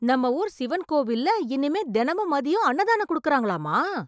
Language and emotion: Tamil, surprised